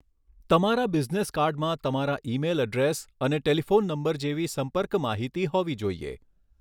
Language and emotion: Gujarati, neutral